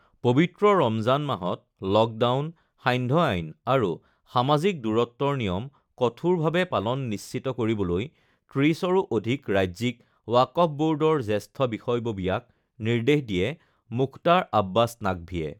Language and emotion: Assamese, neutral